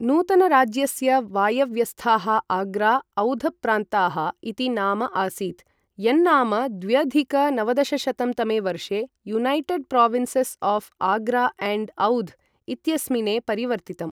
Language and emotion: Sanskrit, neutral